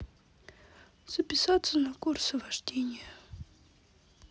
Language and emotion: Russian, sad